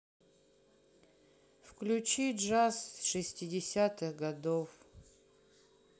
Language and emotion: Russian, sad